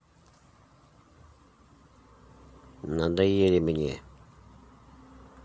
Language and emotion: Russian, neutral